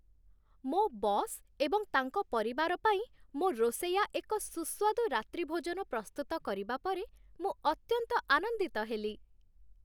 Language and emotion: Odia, happy